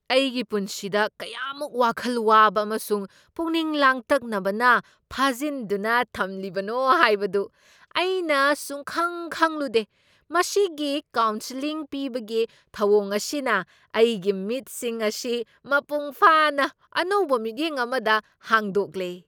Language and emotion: Manipuri, surprised